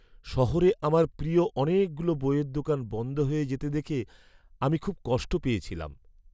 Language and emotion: Bengali, sad